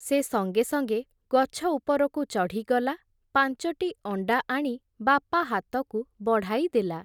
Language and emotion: Odia, neutral